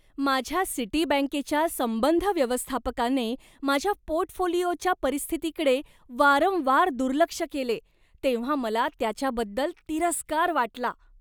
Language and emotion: Marathi, disgusted